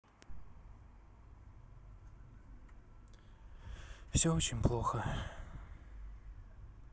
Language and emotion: Russian, sad